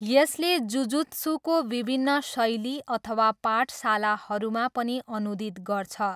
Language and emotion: Nepali, neutral